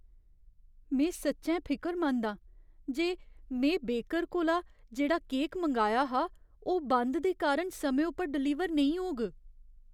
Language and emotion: Dogri, fearful